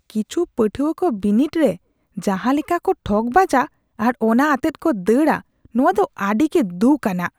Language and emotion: Santali, disgusted